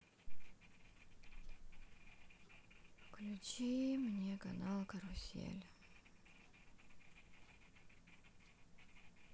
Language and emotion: Russian, sad